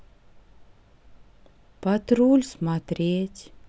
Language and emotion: Russian, sad